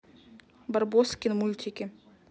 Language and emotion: Russian, neutral